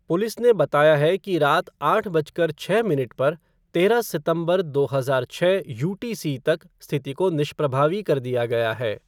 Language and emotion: Hindi, neutral